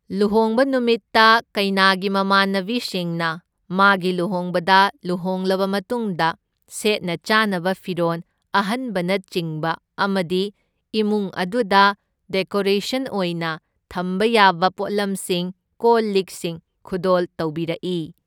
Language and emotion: Manipuri, neutral